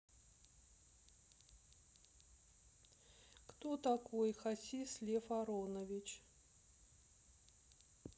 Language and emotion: Russian, neutral